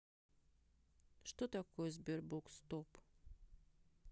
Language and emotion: Russian, neutral